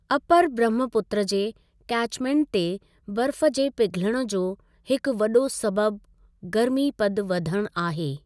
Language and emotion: Sindhi, neutral